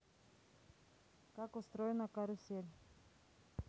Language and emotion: Russian, neutral